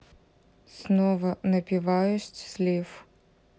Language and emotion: Russian, neutral